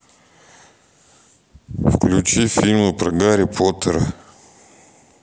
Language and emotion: Russian, neutral